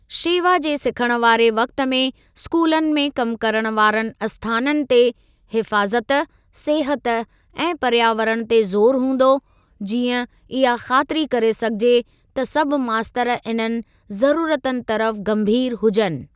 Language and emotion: Sindhi, neutral